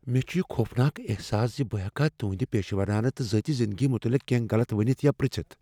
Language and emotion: Kashmiri, fearful